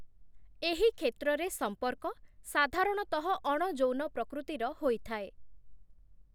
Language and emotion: Odia, neutral